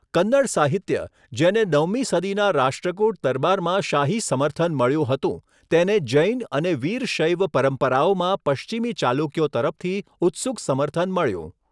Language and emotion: Gujarati, neutral